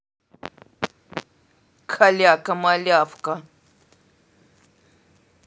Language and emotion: Russian, angry